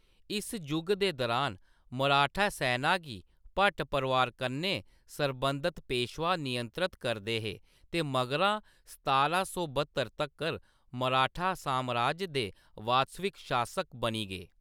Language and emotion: Dogri, neutral